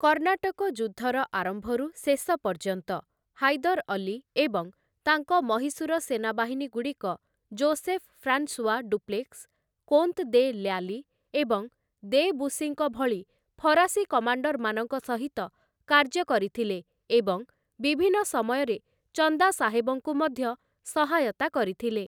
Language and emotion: Odia, neutral